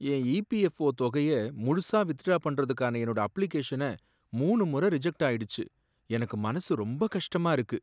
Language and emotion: Tamil, sad